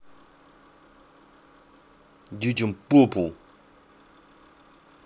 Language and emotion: Russian, angry